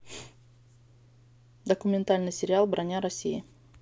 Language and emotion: Russian, neutral